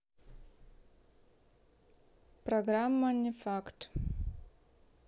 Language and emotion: Russian, neutral